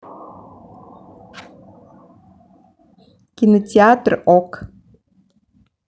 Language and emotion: Russian, neutral